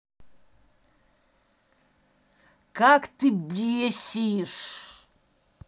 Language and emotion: Russian, angry